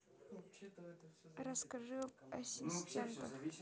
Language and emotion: Russian, neutral